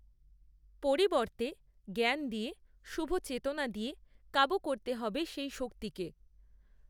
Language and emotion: Bengali, neutral